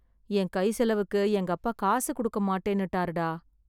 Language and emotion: Tamil, sad